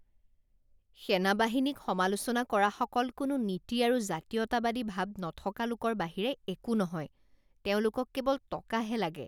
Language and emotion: Assamese, disgusted